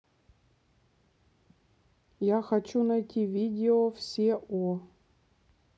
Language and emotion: Russian, neutral